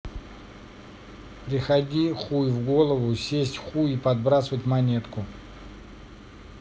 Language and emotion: Russian, angry